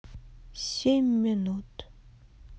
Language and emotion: Russian, sad